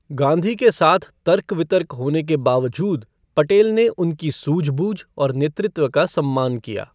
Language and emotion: Hindi, neutral